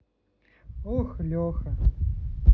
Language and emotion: Russian, sad